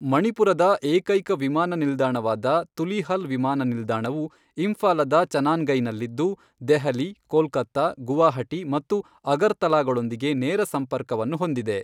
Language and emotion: Kannada, neutral